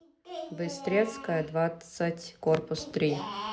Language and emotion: Russian, neutral